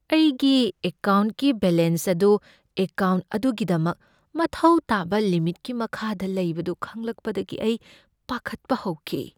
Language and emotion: Manipuri, fearful